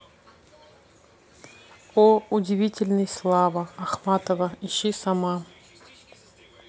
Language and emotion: Russian, neutral